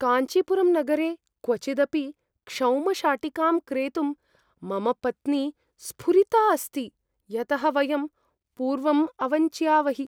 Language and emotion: Sanskrit, fearful